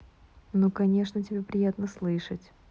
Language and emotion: Russian, neutral